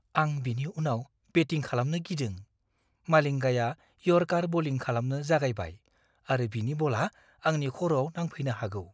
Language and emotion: Bodo, fearful